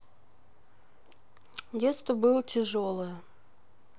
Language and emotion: Russian, sad